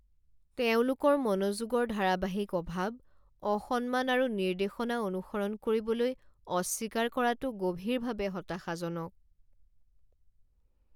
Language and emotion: Assamese, sad